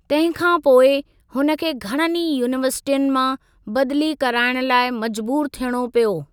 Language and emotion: Sindhi, neutral